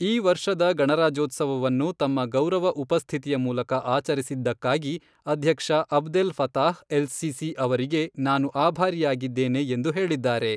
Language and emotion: Kannada, neutral